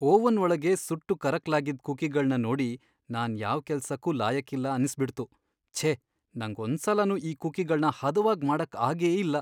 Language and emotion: Kannada, sad